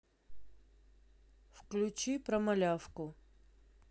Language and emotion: Russian, neutral